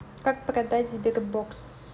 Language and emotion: Russian, neutral